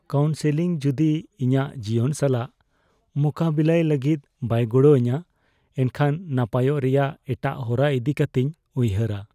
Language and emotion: Santali, fearful